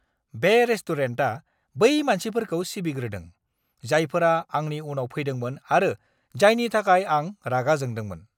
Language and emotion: Bodo, angry